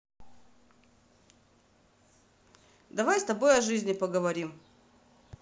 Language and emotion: Russian, neutral